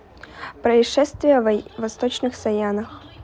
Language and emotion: Russian, neutral